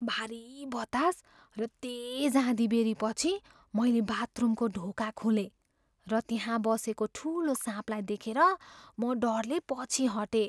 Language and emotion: Nepali, fearful